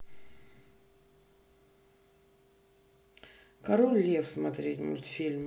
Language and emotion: Russian, neutral